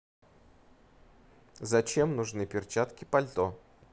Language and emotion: Russian, neutral